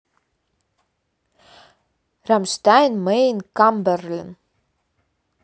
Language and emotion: Russian, neutral